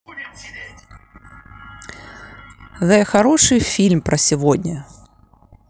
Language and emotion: Russian, neutral